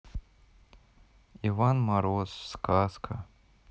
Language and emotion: Russian, sad